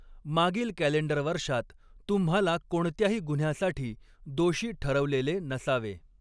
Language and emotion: Marathi, neutral